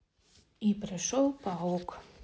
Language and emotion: Russian, neutral